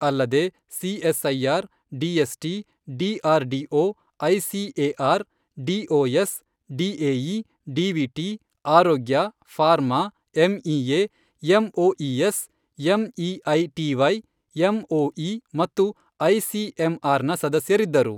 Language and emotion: Kannada, neutral